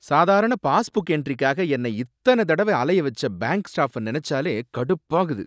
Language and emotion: Tamil, angry